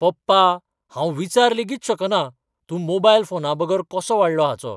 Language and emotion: Goan Konkani, surprised